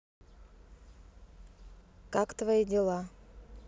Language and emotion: Russian, neutral